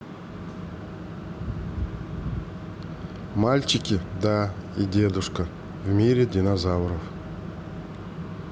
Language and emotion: Russian, neutral